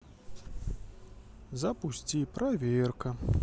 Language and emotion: Russian, neutral